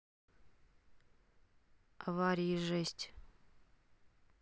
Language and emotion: Russian, sad